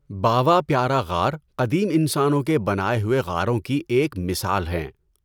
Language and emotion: Urdu, neutral